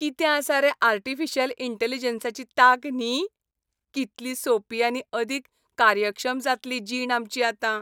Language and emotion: Goan Konkani, happy